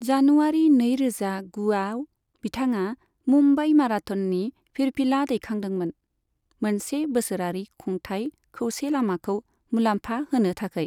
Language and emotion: Bodo, neutral